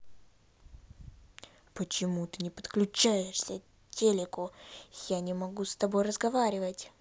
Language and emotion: Russian, angry